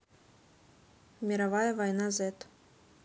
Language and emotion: Russian, neutral